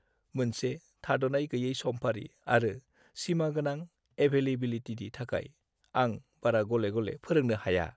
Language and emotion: Bodo, sad